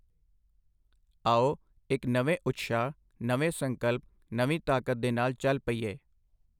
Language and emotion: Punjabi, neutral